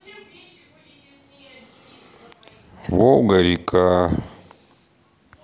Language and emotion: Russian, sad